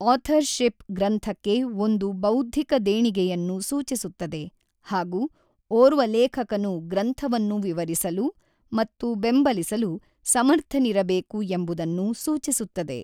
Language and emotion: Kannada, neutral